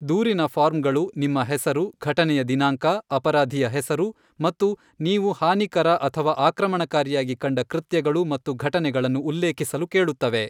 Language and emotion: Kannada, neutral